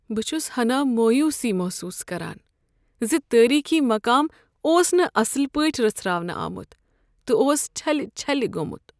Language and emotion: Kashmiri, sad